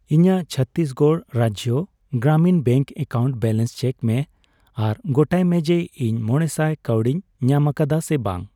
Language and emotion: Santali, neutral